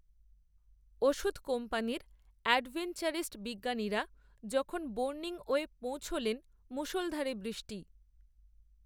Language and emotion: Bengali, neutral